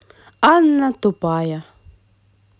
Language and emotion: Russian, positive